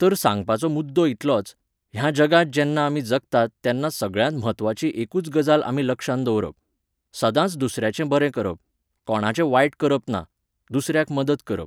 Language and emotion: Goan Konkani, neutral